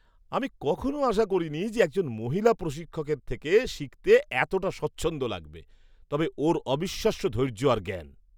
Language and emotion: Bengali, surprised